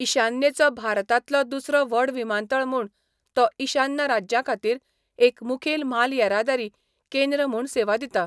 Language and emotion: Goan Konkani, neutral